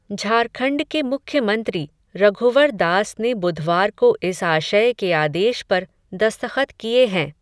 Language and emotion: Hindi, neutral